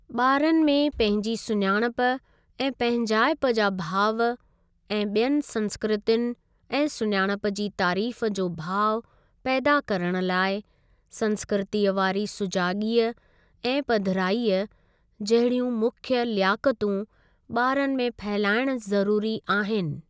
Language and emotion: Sindhi, neutral